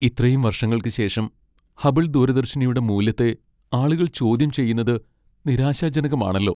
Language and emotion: Malayalam, sad